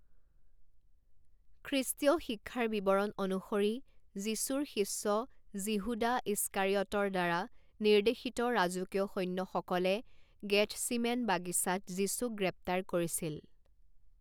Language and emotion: Assamese, neutral